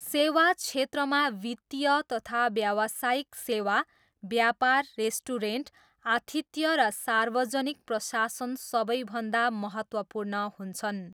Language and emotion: Nepali, neutral